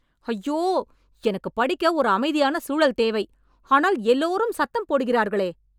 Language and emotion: Tamil, angry